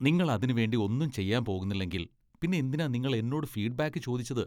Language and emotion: Malayalam, disgusted